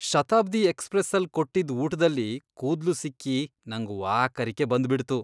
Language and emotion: Kannada, disgusted